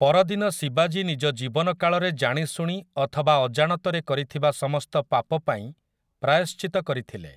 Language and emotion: Odia, neutral